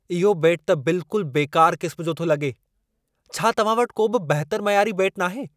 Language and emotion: Sindhi, angry